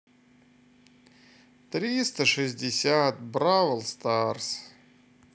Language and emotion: Russian, sad